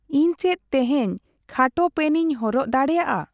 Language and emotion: Santali, neutral